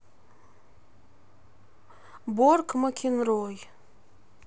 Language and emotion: Russian, neutral